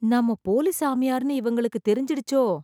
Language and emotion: Tamil, fearful